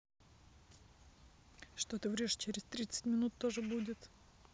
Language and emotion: Russian, neutral